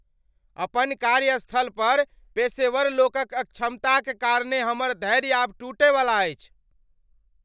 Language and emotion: Maithili, angry